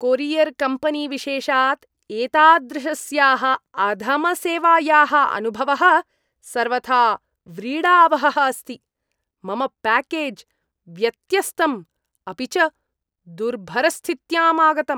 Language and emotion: Sanskrit, disgusted